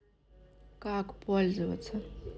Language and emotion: Russian, neutral